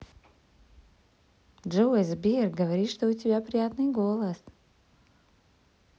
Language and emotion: Russian, positive